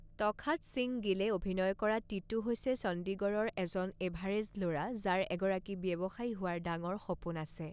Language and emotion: Assamese, neutral